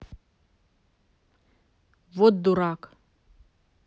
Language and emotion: Russian, neutral